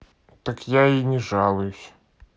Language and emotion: Russian, neutral